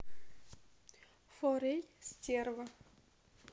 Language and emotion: Russian, neutral